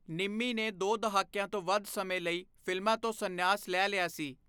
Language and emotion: Punjabi, neutral